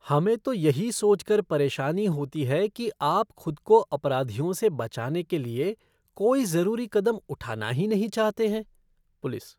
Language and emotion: Hindi, disgusted